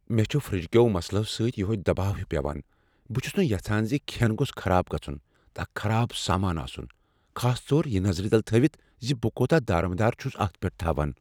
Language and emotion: Kashmiri, fearful